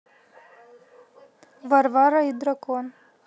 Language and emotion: Russian, neutral